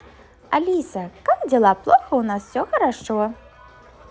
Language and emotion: Russian, positive